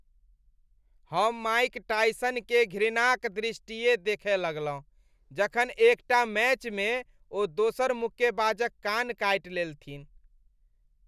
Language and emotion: Maithili, disgusted